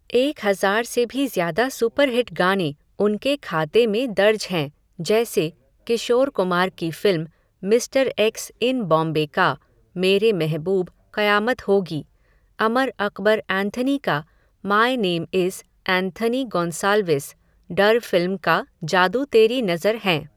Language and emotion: Hindi, neutral